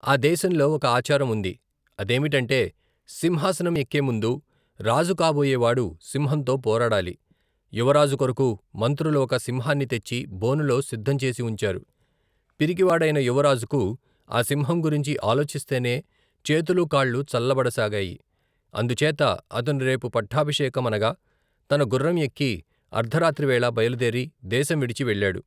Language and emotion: Telugu, neutral